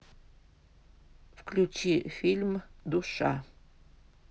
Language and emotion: Russian, neutral